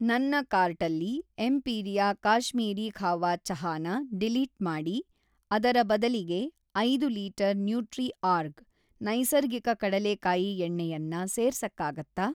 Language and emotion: Kannada, neutral